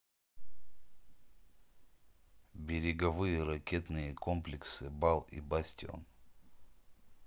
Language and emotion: Russian, neutral